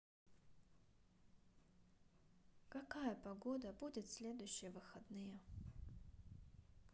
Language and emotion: Russian, sad